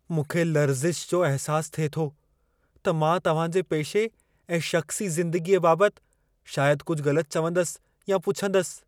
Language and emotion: Sindhi, fearful